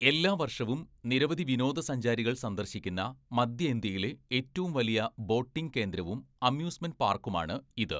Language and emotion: Malayalam, neutral